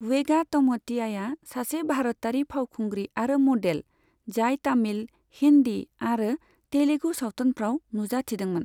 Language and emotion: Bodo, neutral